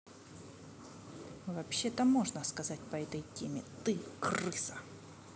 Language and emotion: Russian, angry